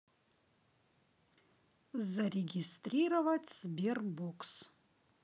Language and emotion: Russian, neutral